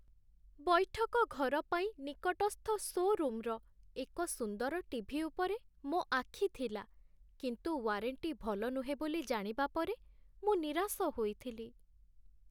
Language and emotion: Odia, sad